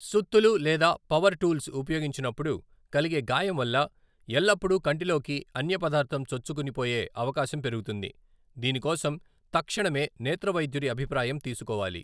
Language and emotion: Telugu, neutral